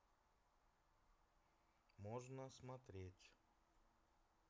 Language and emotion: Russian, neutral